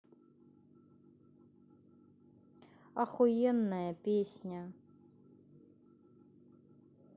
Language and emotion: Russian, neutral